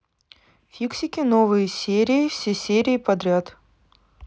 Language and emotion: Russian, neutral